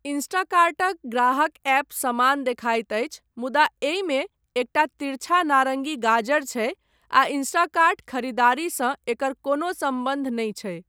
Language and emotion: Maithili, neutral